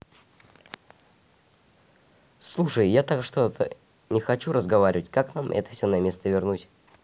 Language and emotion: Russian, neutral